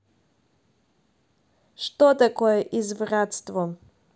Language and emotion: Russian, neutral